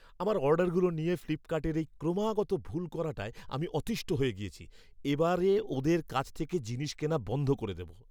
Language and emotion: Bengali, angry